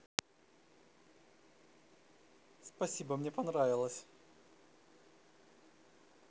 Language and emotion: Russian, positive